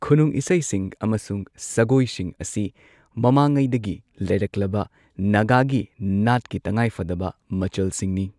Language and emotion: Manipuri, neutral